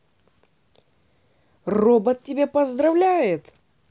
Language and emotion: Russian, positive